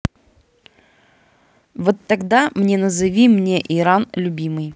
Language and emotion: Russian, neutral